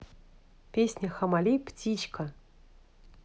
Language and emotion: Russian, neutral